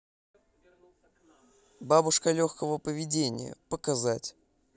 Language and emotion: Russian, neutral